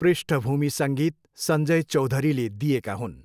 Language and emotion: Nepali, neutral